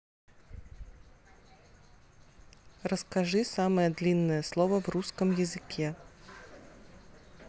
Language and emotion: Russian, neutral